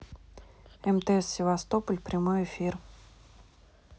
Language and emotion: Russian, neutral